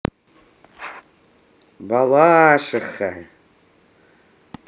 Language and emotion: Russian, positive